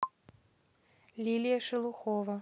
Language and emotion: Russian, neutral